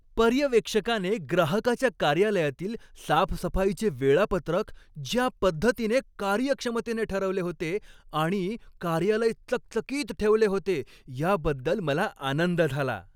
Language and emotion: Marathi, happy